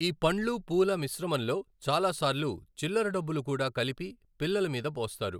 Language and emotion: Telugu, neutral